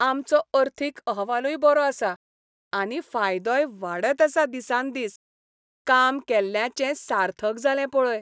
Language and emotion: Goan Konkani, happy